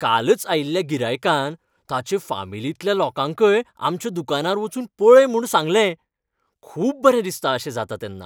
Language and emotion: Goan Konkani, happy